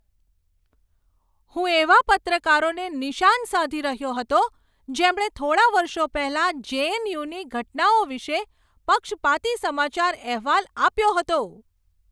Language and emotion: Gujarati, angry